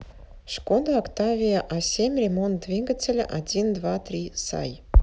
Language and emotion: Russian, neutral